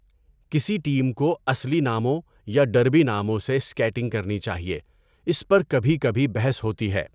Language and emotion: Urdu, neutral